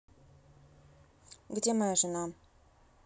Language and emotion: Russian, neutral